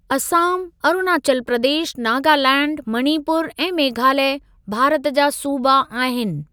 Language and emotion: Sindhi, neutral